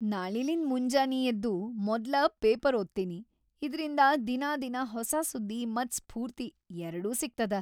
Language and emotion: Kannada, happy